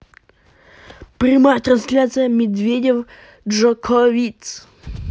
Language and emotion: Russian, positive